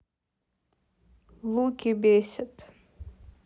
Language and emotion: Russian, neutral